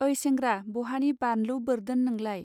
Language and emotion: Bodo, neutral